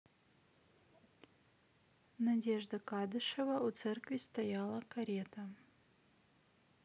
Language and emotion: Russian, neutral